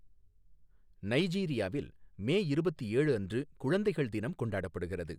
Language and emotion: Tamil, neutral